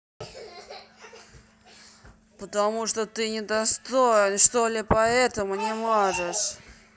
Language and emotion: Russian, angry